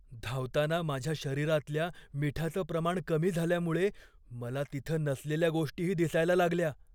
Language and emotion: Marathi, fearful